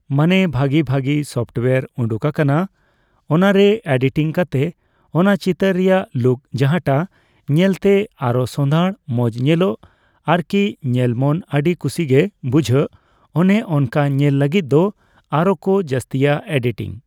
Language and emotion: Santali, neutral